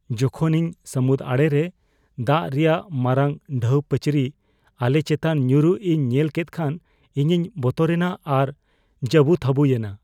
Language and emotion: Santali, fearful